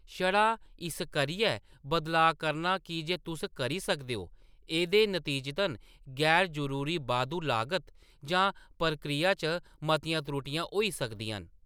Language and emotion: Dogri, neutral